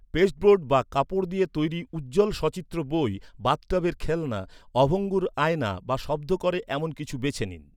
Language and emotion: Bengali, neutral